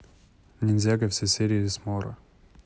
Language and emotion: Russian, neutral